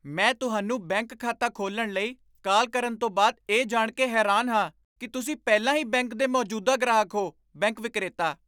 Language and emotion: Punjabi, surprised